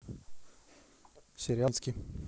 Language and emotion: Russian, neutral